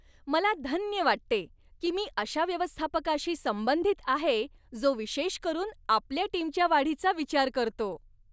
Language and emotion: Marathi, happy